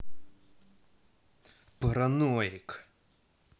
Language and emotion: Russian, angry